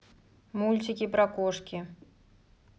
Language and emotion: Russian, neutral